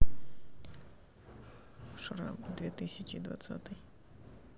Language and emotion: Russian, neutral